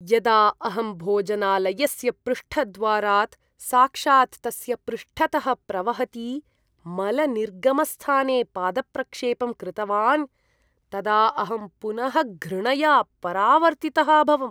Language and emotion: Sanskrit, disgusted